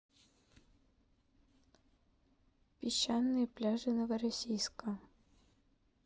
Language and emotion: Russian, neutral